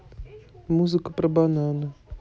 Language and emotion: Russian, neutral